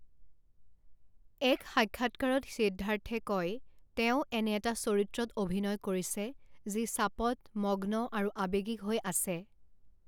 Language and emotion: Assamese, neutral